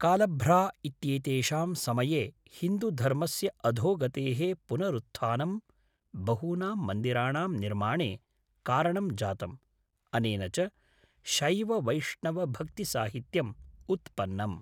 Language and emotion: Sanskrit, neutral